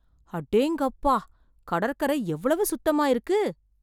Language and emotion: Tamil, surprised